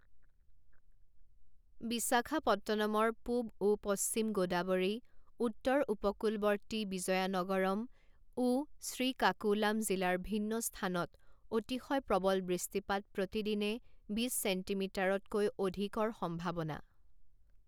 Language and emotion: Assamese, neutral